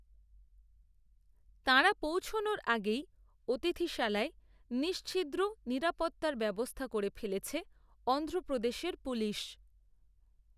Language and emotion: Bengali, neutral